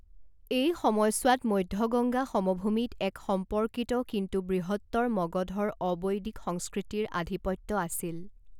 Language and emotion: Assamese, neutral